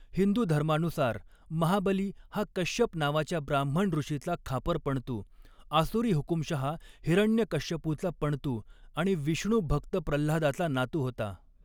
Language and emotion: Marathi, neutral